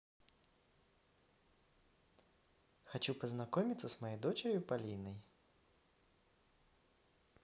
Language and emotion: Russian, positive